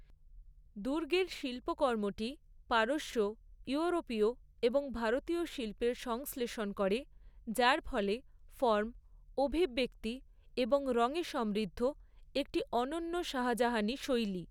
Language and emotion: Bengali, neutral